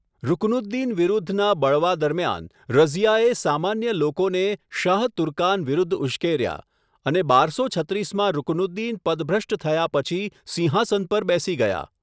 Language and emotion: Gujarati, neutral